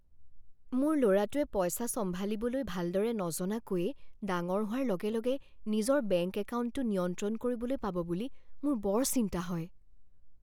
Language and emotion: Assamese, fearful